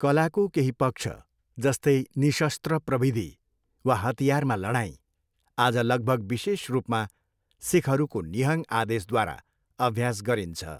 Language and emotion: Nepali, neutral